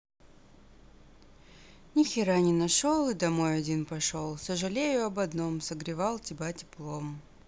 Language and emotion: Russian, sad